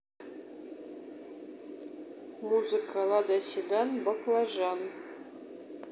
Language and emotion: Russian, neutral